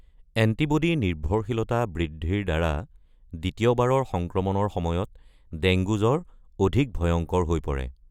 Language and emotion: Assamese, neutral